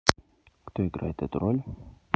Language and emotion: Russian, neutral